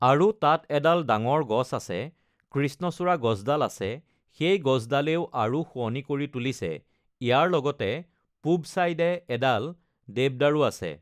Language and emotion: Assamese, neutral